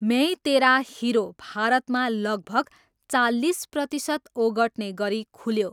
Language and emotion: Nepali, neutral